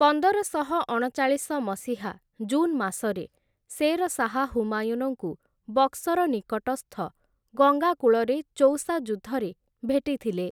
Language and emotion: Odia, neutral